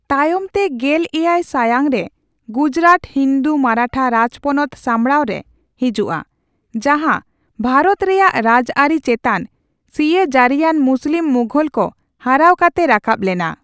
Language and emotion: Santali, neutral